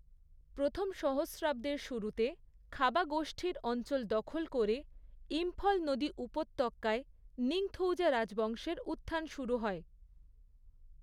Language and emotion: Bengali, neutral